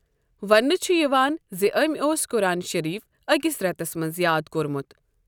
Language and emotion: Kashmiri, neutral